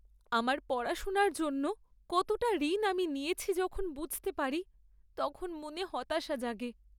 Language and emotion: Bengali, sad